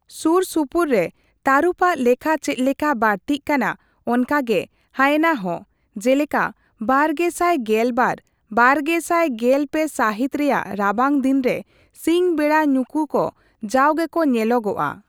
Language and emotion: Santali, neutral